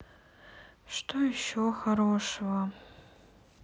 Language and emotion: Russian, sad